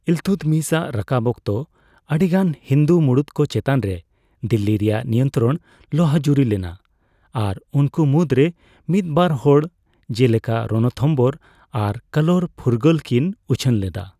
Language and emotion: Santali, neutral